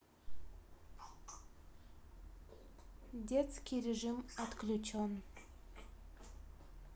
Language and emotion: Russian, neutral